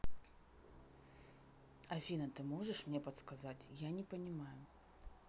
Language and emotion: Russian, neutral